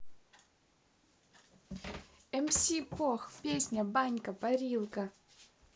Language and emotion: Russian, positive